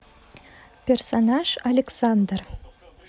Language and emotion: Russian, neutral